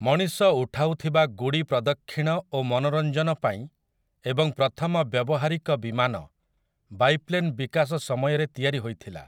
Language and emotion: Odia, neutral